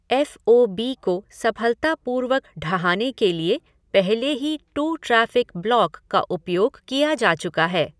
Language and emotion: Hindi, neutral